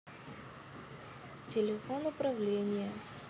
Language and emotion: Russian, neutral